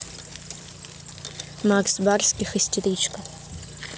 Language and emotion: Russian, neutral